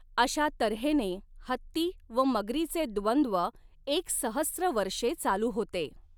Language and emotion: Marathi, neutral